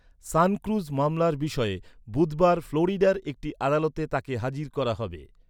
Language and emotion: Bengali, neutral